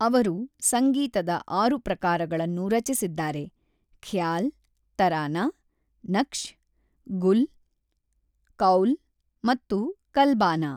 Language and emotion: Kannada, neutral